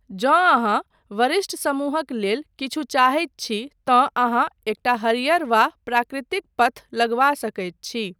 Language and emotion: Maithili, neutral